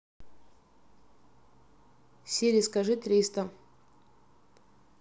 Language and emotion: Russian, neutral